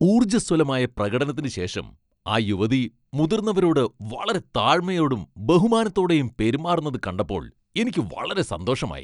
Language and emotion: Malayalam, happy